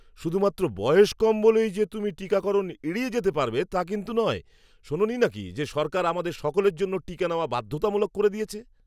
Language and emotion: Bengali, angry